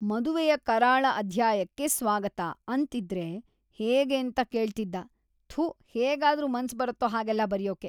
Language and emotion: Kannada, disgusted